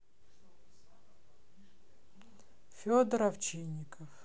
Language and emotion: Russian, neutral